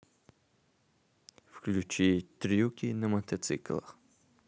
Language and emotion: Russian, neutral